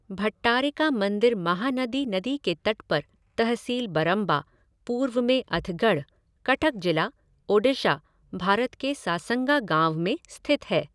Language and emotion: Hindi, neutral